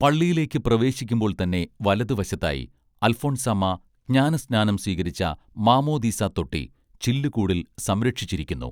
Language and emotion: Malayalam, neutral